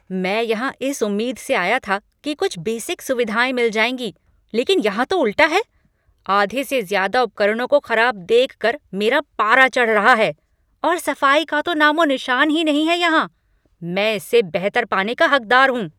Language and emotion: Hindi, angry